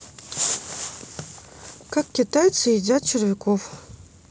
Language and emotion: Russian, neutral